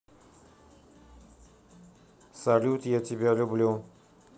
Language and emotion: Russian, neutral